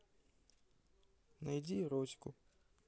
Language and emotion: Russian, neutral